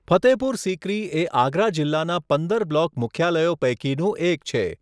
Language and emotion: Gujarati, neutral